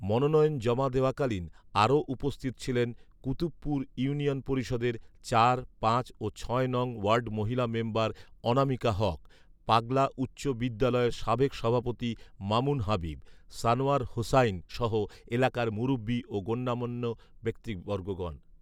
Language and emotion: Bengali, neutral